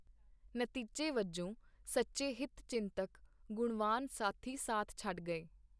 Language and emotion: Punjabi, neutral